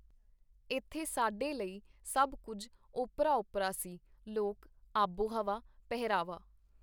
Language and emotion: Punjabi, neutral